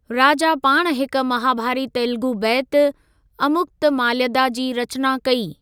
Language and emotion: Sindhi, neutral